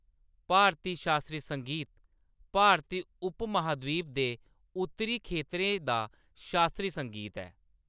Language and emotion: Dogri, neutral